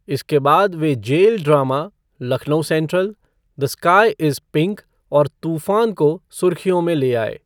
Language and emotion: Hindi, neutral